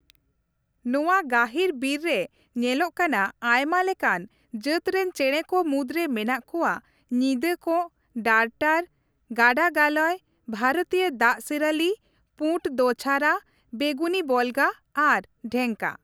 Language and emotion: Santali, neutral